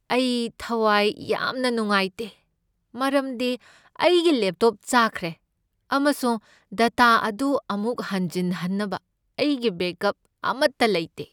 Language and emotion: Manipuri, sad